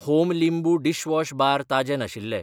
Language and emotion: Goan Konkani, neutral